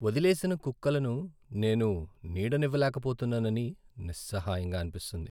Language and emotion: Telugu, sad